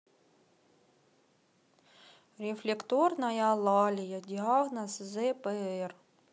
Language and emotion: Russian, sad